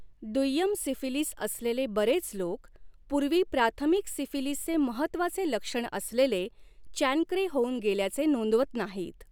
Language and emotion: Marathi, neutral